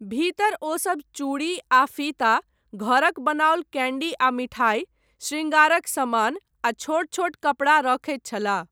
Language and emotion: Maithili, neutral